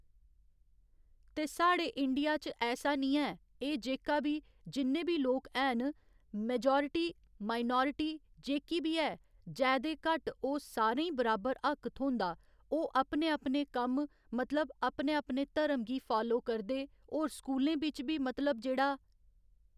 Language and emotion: Dogri, neutral